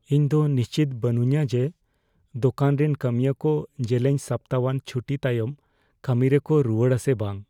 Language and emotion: Santali, fearful